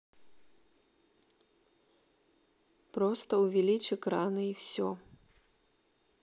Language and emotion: Russian, neutral